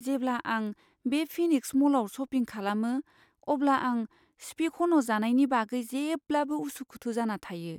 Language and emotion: Bodo, fearful